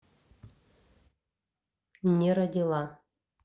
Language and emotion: Russian, neutral